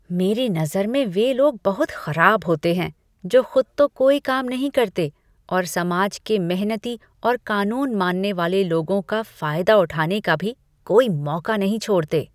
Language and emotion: Hindi, disgusted